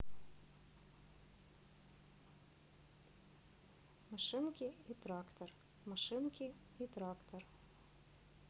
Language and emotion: Russian, neutral